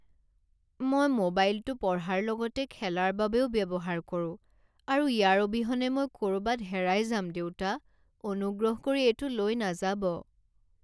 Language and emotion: Assamese, sad